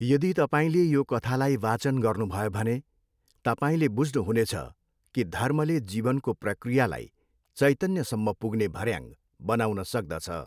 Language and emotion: Nepali, neutral